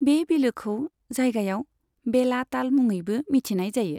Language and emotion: Bodo, neutral